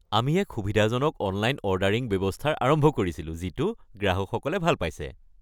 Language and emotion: Assamese, happy